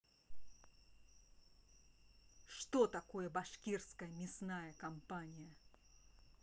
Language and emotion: Russian, angry